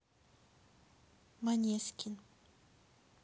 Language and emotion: Russian, neutral